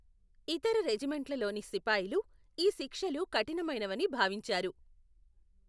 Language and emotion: Telugu, neutral